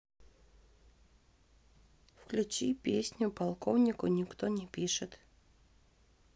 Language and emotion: Russian, neutral